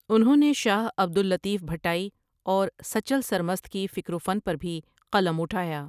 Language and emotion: Urdu, neutral